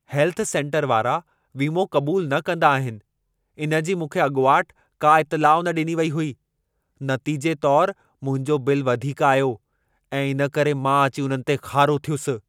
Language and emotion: Sindhi, angry